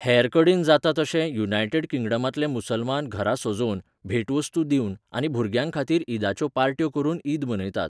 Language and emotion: Goan Konkani, neutral